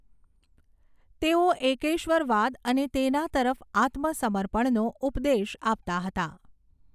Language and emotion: Gujarati, neutral